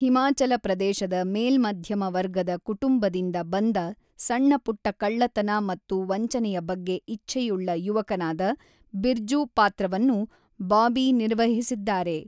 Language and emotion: Kannada, neutral